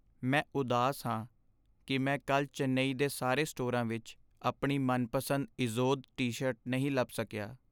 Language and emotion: Punjabi, sad